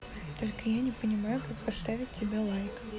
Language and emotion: Russian, neutral